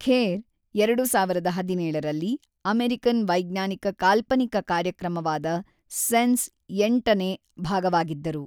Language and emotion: Kannada, neutral